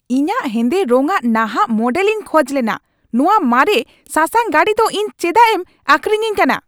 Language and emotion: Santali, angry